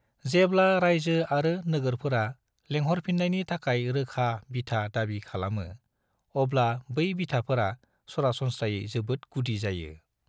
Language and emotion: Bodo, neutral